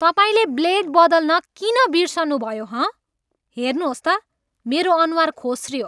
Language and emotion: Nepali, angry